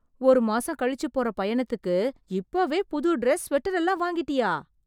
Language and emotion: Tamil, surprised